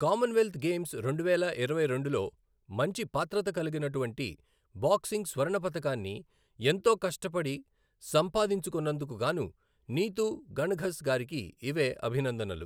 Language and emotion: Telugu, neutral